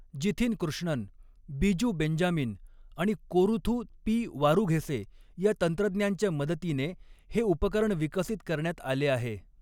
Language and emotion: Marathi, neutral